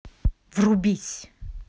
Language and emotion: Russian, angry